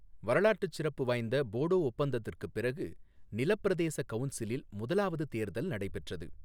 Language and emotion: Tamil, neutral